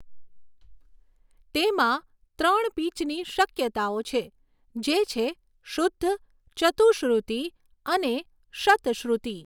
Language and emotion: Gujarati, neutral